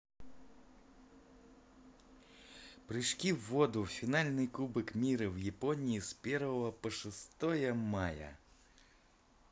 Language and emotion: Russian, positive